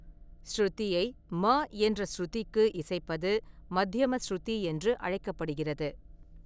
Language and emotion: Tamil, neutral